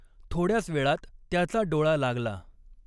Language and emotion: Marathi, neutral